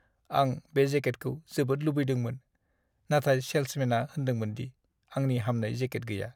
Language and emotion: Bodo, sad